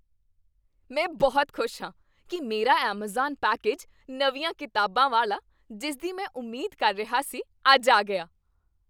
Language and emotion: Punjabi, happy